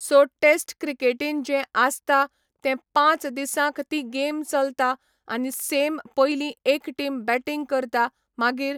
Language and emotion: Goan Konkani, neutral